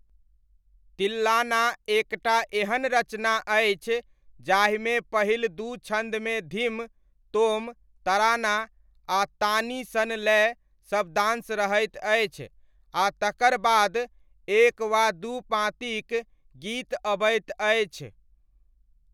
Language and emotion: Maithili, neutral